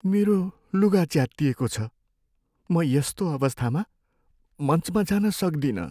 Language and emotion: Nepali, sad